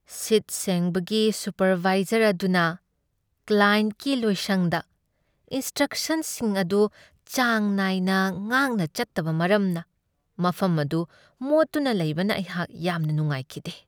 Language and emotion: Manipuri, sad